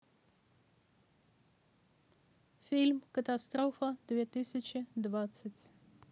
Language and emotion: Russian, neutral